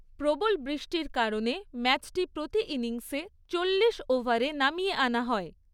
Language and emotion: Bengali, neutral